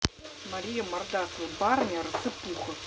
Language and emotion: Russian, neutral